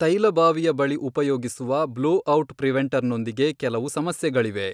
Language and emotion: Kannada, neutral